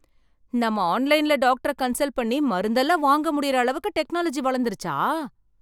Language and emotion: Tamil, surprised